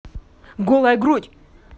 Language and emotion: Russian, angry